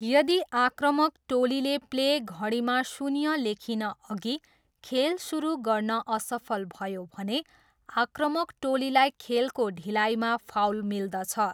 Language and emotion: Nepali, neutral